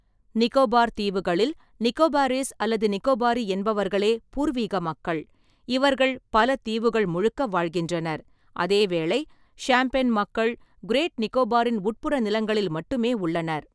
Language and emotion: Tamil, neutral